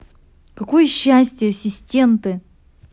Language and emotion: Russian, angry